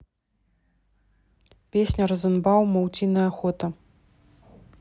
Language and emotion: Russian, neutral